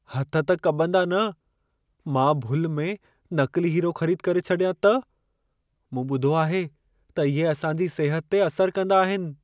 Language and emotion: Sindhi, fearful